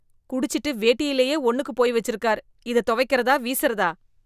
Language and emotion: Tamil, disgusted